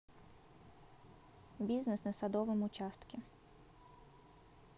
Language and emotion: Russian, neutral